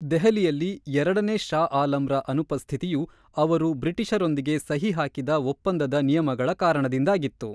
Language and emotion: Kannada, neutral